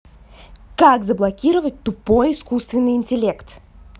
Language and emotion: Russian, angry